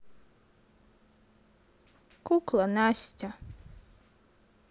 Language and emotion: Russian, sad